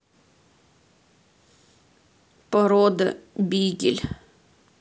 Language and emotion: Russian, neutral